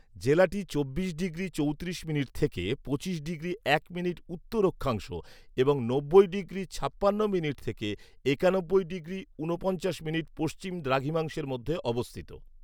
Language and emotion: Bengali, neutral